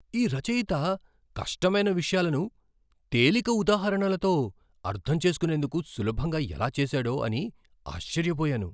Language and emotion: Telugu, surprised